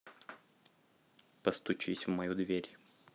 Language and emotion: Russian, neutral